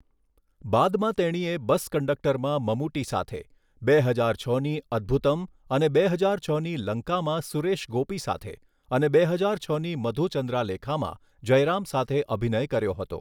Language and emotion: Gujarati, neutral